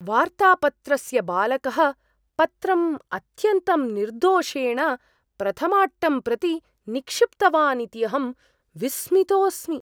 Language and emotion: Sanskrit, surprised